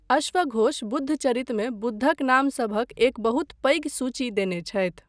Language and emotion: Maithili, neutral